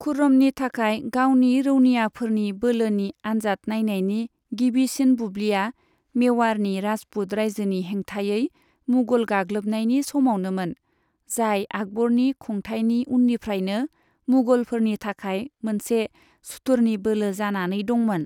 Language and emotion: Bodo, neutral